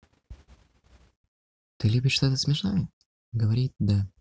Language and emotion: Russian, neutral